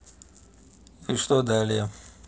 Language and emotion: Russian, neutral